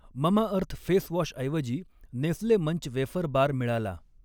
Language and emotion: Marathi, neutral